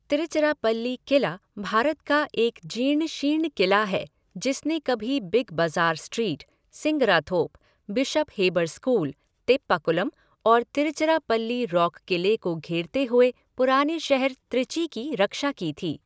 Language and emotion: Hindi, neutral